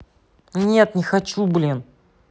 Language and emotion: Russian, angry